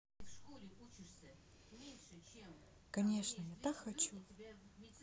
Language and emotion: Russian, neutral